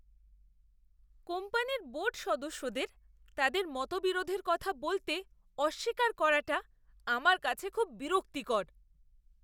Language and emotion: Bengali, disgusted